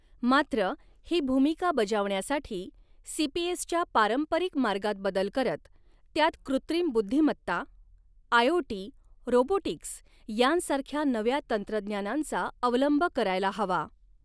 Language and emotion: Marathi, neutral